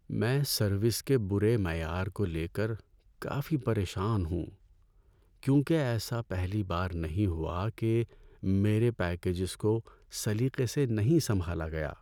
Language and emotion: Urdu, sad